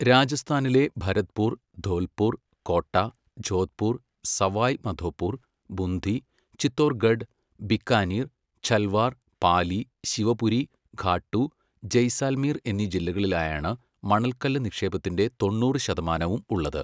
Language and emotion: Malayalam, neutral